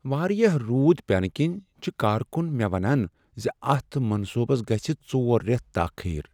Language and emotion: Kashmiri, sad